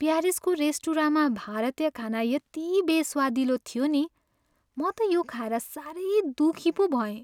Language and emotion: Nepali, sad